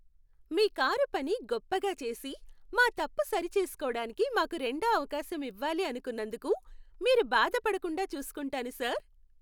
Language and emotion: Telugu, happy